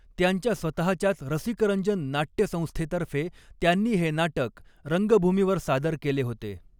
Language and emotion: Marathi, neutral